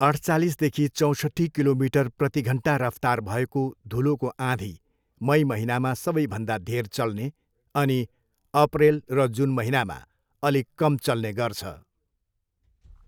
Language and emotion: Nepali, neutral